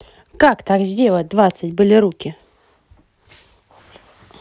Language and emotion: Russian, positive